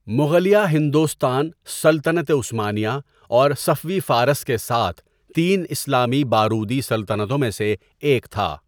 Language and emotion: Urdu, neutral